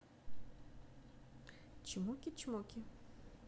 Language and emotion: Russian, neutral